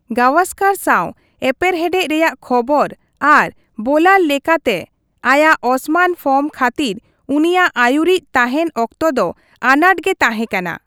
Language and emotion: Santali, neutral